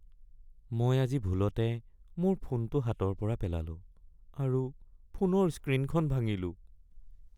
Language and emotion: Assamese, sad